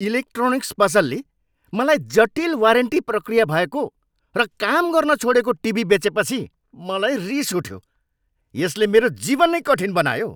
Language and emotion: Nepali, angry